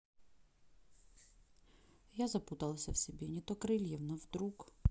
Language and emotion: Russian, neutral